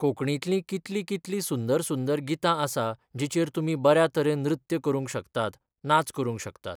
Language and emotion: Goan Konkani, neutral